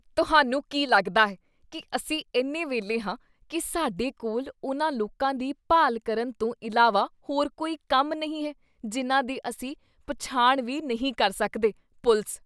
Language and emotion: Punjabi, disgusted